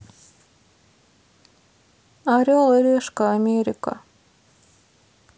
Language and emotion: Russian, sad